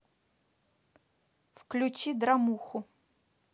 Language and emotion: Russian, neutral